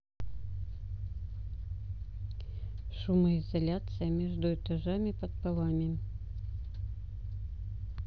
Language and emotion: Russian, neutral